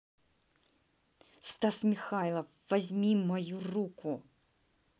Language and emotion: Russian, angry